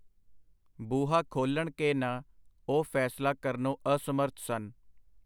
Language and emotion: Punjabi, neutral